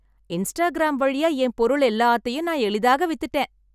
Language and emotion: Tamil, happy